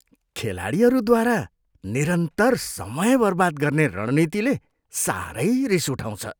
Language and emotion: Nepali, disgusted